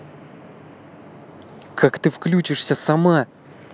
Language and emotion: Russian, angry